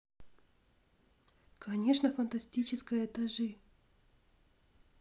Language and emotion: Russian, neutral